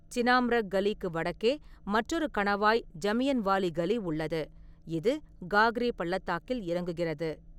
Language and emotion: Tamil, neutral